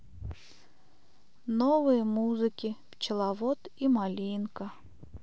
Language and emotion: Russian, sad